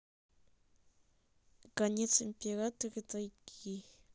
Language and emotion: Russian, neutral